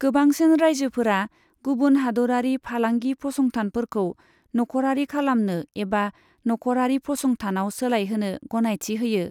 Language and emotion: Bodo, neutral